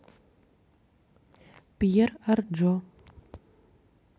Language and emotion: Russian, neutral